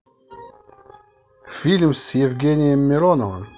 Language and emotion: Russian, positive